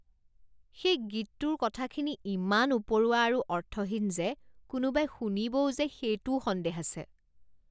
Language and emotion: Assamese, disgusted